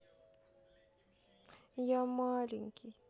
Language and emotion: Russian, sad